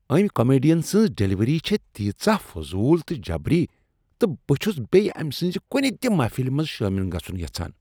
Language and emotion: Kashmiri, disgusted